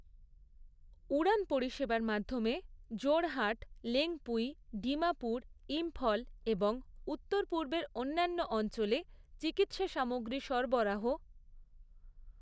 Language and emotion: Bengali, neutral